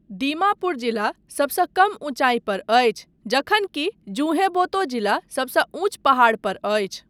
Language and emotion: Maithili, neutral